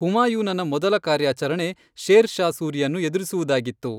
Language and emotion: Kannada, neutral